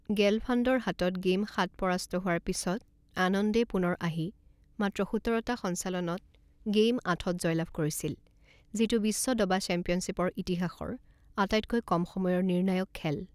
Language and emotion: Assamese, neutral